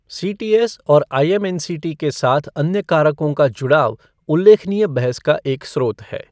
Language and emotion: Hindi, neutral